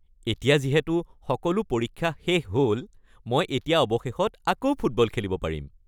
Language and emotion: Assamese, happy